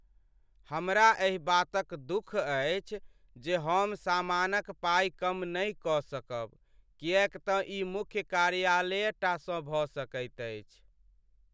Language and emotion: Maithili, sad